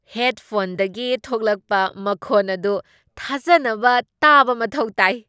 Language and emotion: Manipuri, surprised